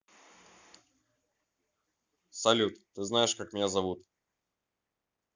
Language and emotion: Russian, neutral